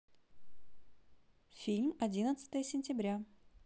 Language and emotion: Russian, neutral